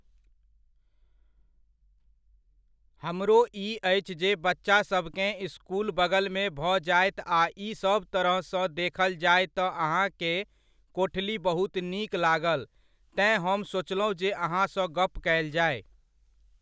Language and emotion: Maithili, neutral